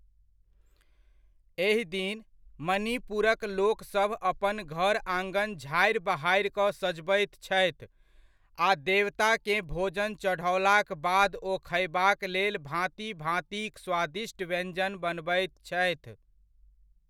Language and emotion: Maithili, neutral